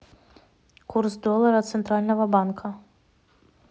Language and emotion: Russian, neutral